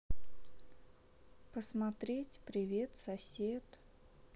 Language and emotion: Russian, neutral